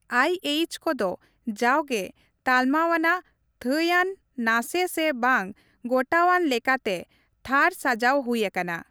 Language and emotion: Santali, neutral